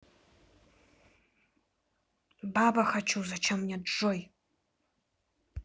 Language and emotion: Russian, angry